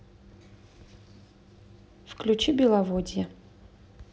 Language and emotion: Russian, neutral